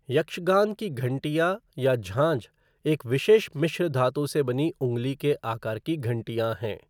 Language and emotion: Hindi, neutral